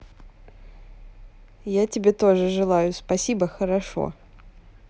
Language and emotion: Russian, positive